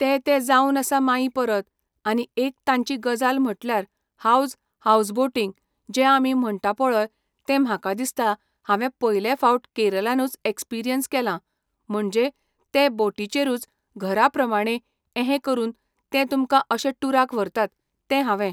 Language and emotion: Goan Konkani, neutral